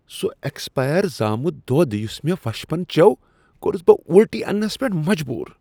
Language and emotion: Kashmiri, disgusted